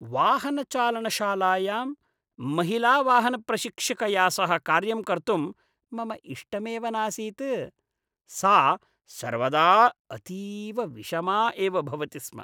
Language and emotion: Sanskrit, disgusted